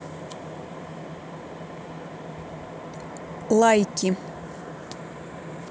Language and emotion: Russian, neutral